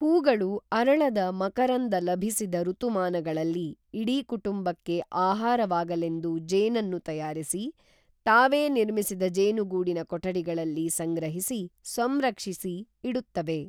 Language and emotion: Kannada, neutral